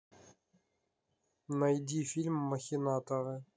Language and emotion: Russian, neutral